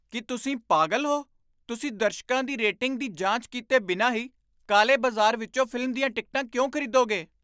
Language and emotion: Punjabi, surprised